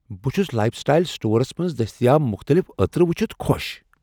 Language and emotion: Kashmiri, surprised